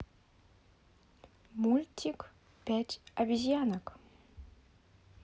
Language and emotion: Russian, positive